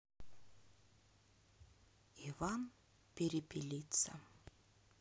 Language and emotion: Russian, neutral